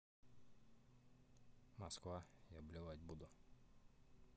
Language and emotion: Russian, neutral